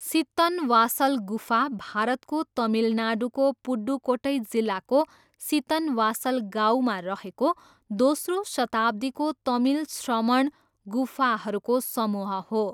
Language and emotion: Nepali, neutral